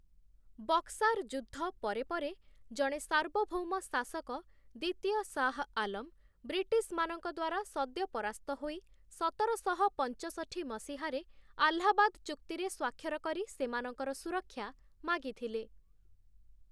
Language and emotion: Odia, neutral